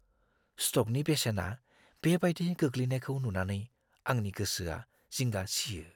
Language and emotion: Bodo, fearful